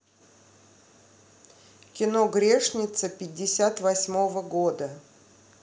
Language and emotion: Russian, neutral